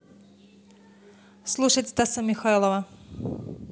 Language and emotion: Russian, neutral